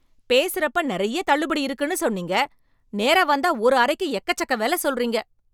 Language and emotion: Tamil, angry